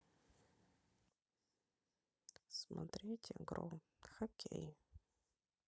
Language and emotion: Russian, sad